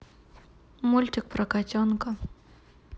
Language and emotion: Russian, neutral